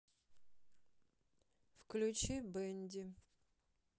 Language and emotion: Russian, sad